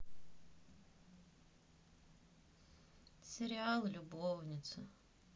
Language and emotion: Russian, sad